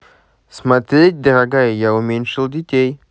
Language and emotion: Russian, positive